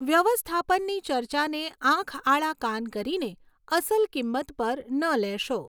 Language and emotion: Gujarati, neutral